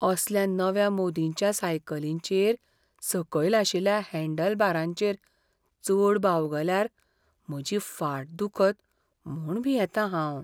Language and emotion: Goan Konkani, fearful